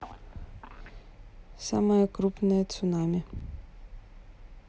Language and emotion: Russian, neutral